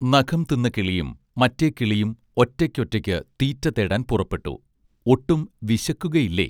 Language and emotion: Malayalam, neutral